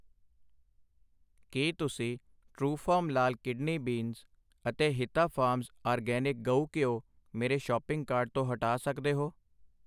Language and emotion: Punjabi, neutral